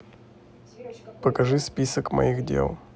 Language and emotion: Russian, neutral